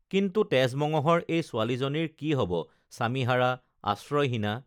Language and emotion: Assamese, neutral